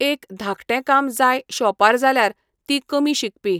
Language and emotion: Goan Konkani, neutral